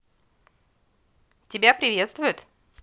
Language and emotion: Russian, positive